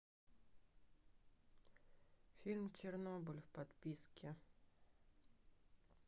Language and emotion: Russian, neutral